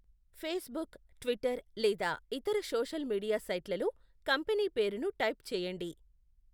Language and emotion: Telugu, neutral